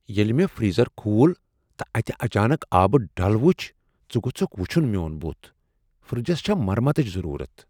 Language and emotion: Kashmiri, surprised